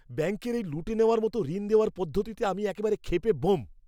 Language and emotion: Bengali, angry